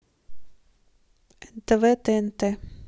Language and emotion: Russian, neutral